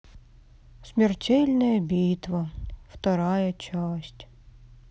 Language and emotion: Russian, sad